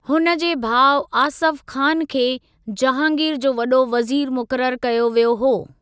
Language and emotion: Sindhi, neutral